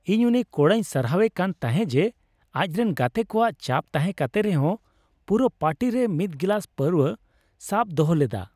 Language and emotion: Santali, happy